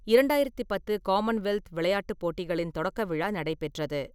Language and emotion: Tamil, neutral